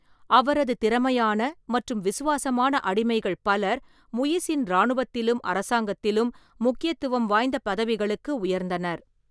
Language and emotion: Tamil, neutral